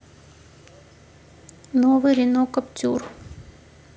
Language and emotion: Russian, neutral